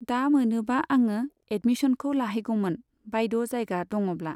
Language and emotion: Bodo, neutral